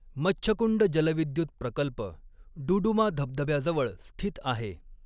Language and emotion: Marathi, neutral